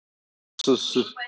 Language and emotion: Russian, neutral